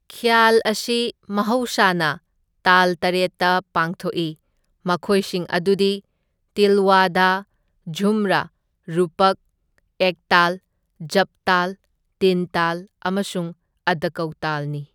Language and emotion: Manipuri, neutral